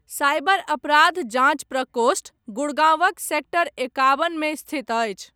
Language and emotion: Maithili, neutral